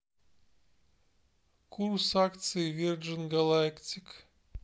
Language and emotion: Russian, neutral